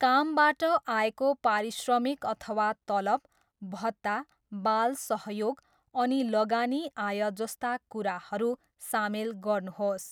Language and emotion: Nepali, neutral